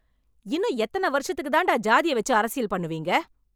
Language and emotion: Tamil, angry